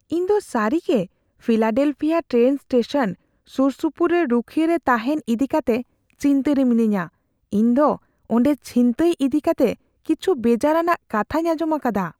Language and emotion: Santali, fearful